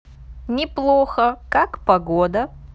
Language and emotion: Russian, neutral